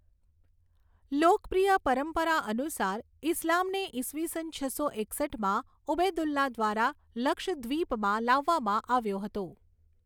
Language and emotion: Gujarati, neutral